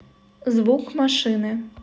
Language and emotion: Russian, neutral